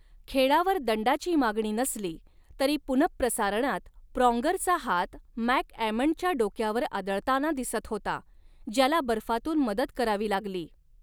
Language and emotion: Marathi, neutral